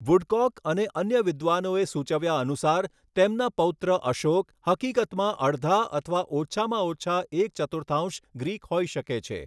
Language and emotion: Gujarati, neutral